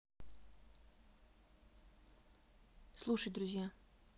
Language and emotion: Russian, neutral